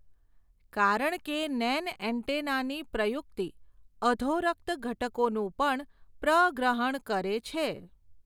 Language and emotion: Gujarati, neutral